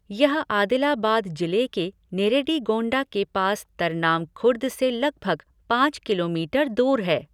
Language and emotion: Hindi, neutral